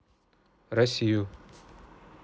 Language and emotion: Russian, neutral